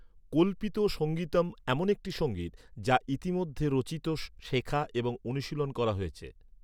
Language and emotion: Bengali, neutral